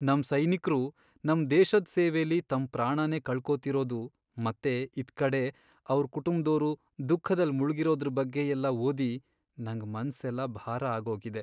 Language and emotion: Kannada, sad